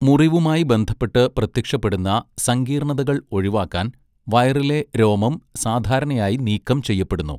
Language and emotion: Malayalam, neutral